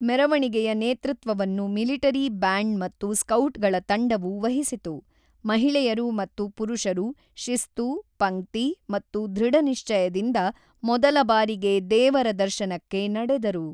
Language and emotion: Kannada, neutral